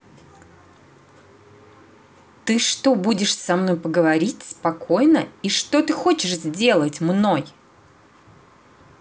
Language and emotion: Russian, angry